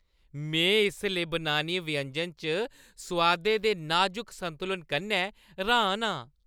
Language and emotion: Dogri, happy